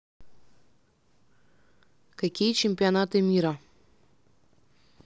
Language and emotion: Russian, neutral